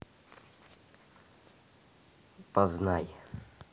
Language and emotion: Russian, neutral